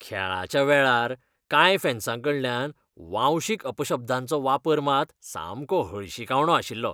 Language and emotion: Goan Konkani, disgusted